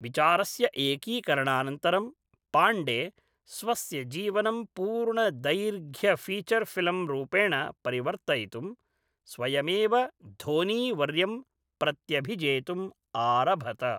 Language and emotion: Sanskrit, neutral